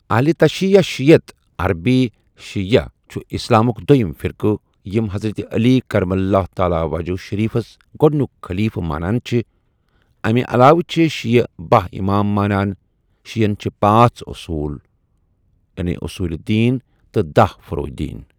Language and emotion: Kashmiri, neutral